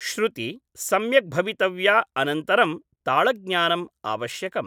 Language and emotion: Sanskrit, neutral